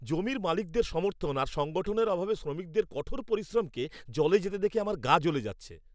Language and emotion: Bengali, angry